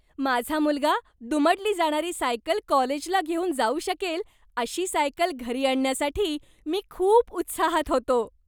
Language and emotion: Marathi, happy